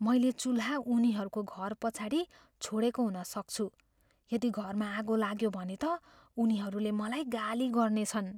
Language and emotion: Nepali, fearful